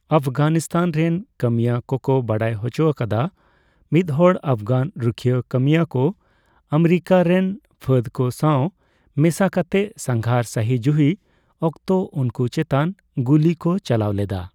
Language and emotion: Santali, neutral